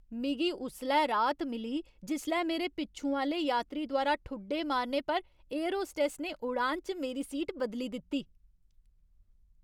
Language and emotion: Dogri, happy